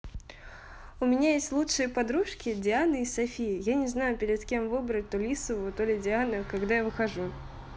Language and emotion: Russian, positive